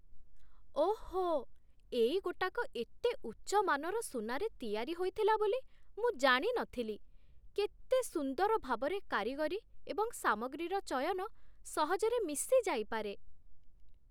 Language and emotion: Odia, surprised